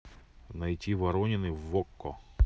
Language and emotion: Russian, neutral